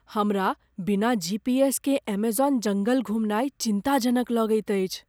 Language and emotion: Maithili, fearful